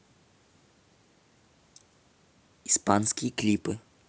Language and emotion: Russian, neutral